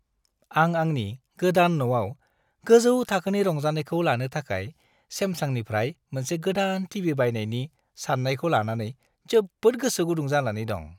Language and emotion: Bodo, happy